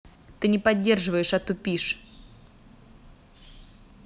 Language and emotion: Russian, angry